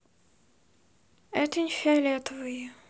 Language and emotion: Russian, neutral